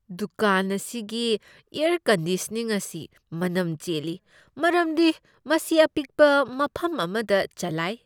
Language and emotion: Manipuri, disgusted